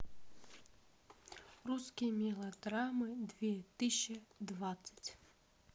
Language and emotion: Russian, neutral